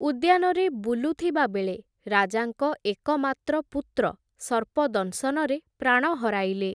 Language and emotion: Odia, neutral